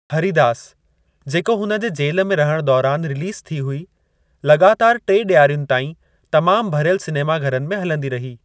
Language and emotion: Sindhi, neutral